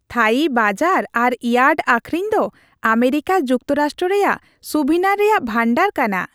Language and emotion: Santali, happy